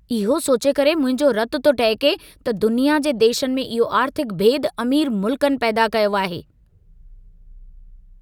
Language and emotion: Sindhi, angry